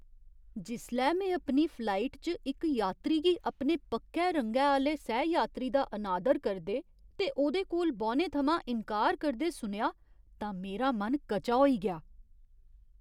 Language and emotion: Dogri, disgusted